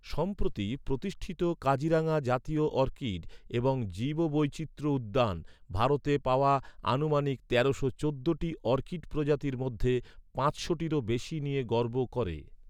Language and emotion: Bengali, neutral